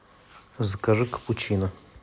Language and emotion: Russian, neutral